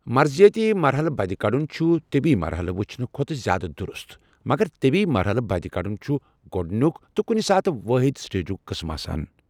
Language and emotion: Kashmiri, neutral